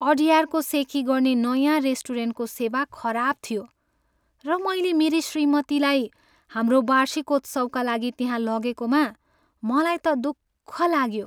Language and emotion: Nepali, sad